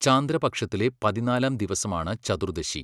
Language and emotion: Malayalam, neutral